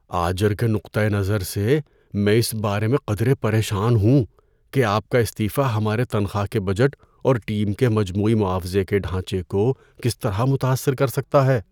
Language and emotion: Urdu, fearful